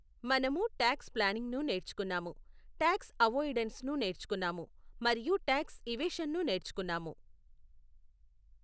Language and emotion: Telugu, neutral